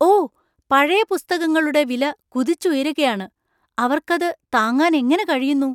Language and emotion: Malayalam, surprised